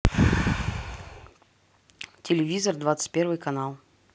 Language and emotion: Russian, neutral